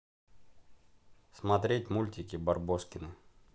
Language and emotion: Russian, neutral